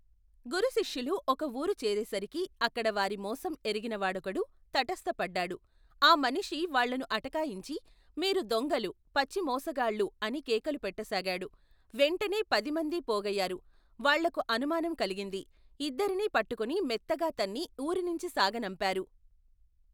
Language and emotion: Telugu, neutral